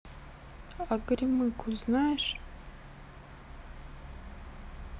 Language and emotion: Russian, sad